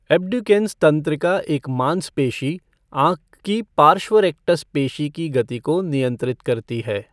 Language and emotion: Hindi, neutral